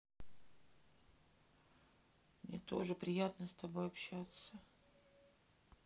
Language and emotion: Russian, sad